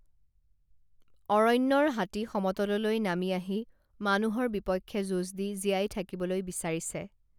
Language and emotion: Assamese, neutral